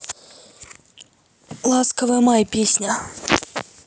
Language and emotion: Russian, neutral